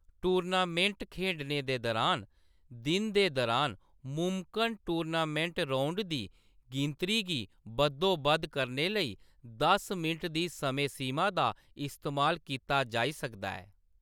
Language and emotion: Dogri, neutral